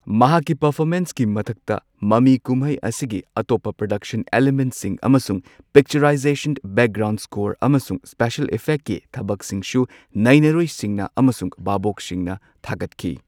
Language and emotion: Manipuri, neutral